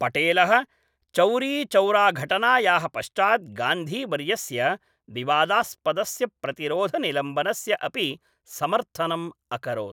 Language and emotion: Sanskrit, neutral